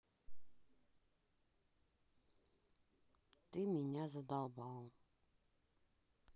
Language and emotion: Russian, sad